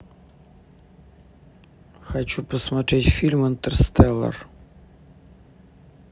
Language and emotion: Russian, neutral